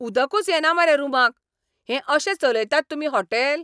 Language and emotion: Goan Konkani, angry